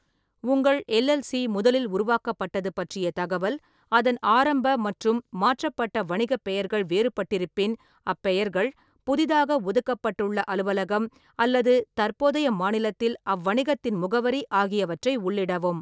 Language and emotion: Tamil, neutral